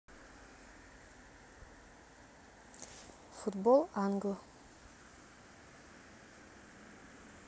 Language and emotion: Russian, neutral